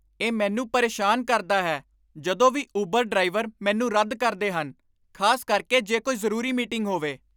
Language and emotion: Punjabi, angry